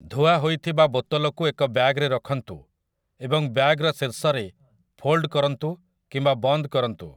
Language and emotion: Odia, neutral